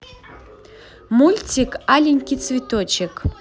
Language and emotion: Russian, positive